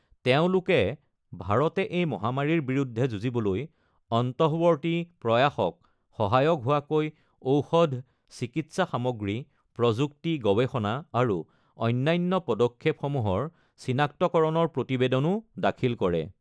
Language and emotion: Assamese, neutral